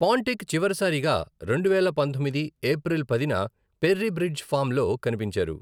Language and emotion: Telugu, neutral